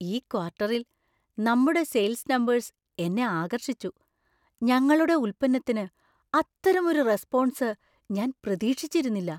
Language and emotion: Malayalam, surprised